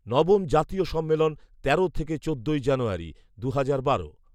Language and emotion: Bengali, neutral